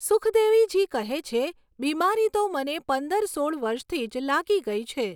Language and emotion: Gujarati, neutral